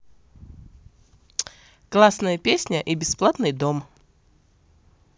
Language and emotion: Russian, positive